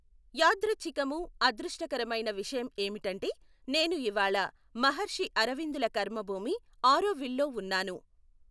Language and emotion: Telugu, neutral